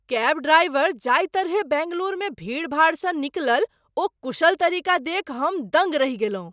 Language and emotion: Maithili, surprised